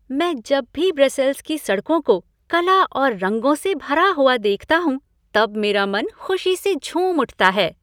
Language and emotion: Hindi, happy